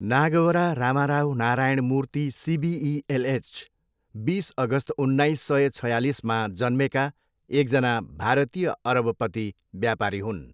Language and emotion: Nepali, neutral